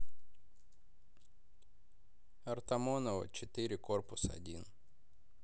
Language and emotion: Russian, neutral